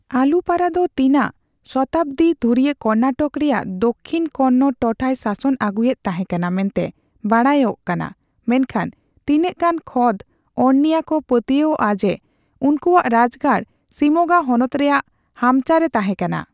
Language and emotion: Santali, neutral